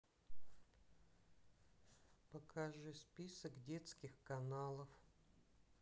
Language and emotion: Russian, sad